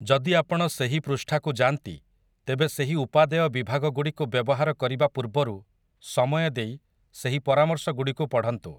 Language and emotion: Odia, neutral